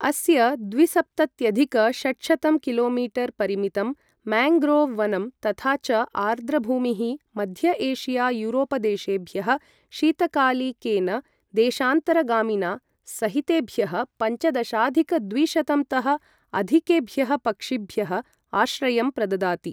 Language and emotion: Sanskrit, neutral